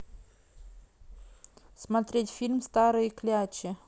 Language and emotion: Russian, neutral